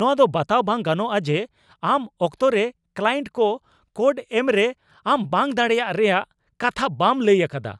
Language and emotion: Santali, angry